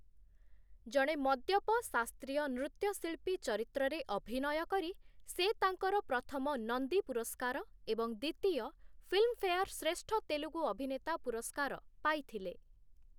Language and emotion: Odia, neutral